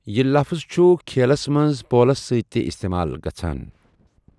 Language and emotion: Kashmiri, neutral